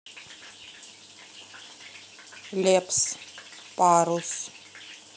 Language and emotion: Russian, neutral